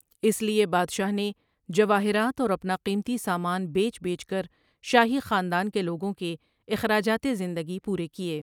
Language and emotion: Urdu, neutral